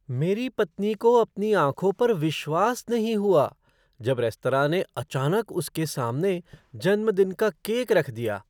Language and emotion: Hindi, surprised